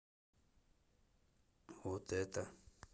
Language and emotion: Russian, neutral